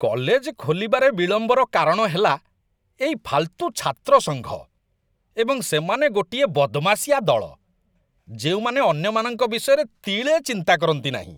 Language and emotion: Odia, disgusted